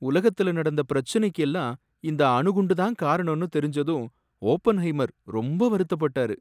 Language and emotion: Tamil, sad